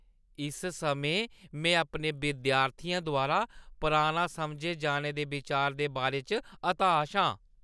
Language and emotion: Dogri, disgusted